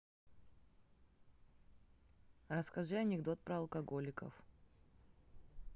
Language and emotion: Russian, neutral